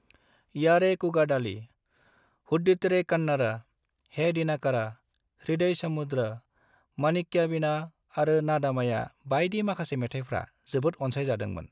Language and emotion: Bodo, neutral